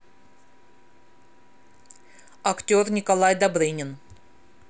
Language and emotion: Russian, neutral